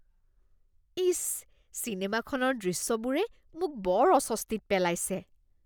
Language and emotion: Assamese, disgusted